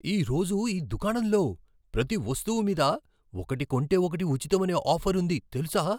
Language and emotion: Telugu, surprised